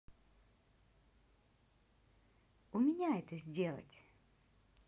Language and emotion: Russian, positive